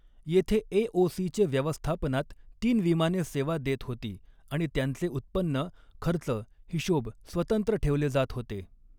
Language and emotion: Marathi, neutral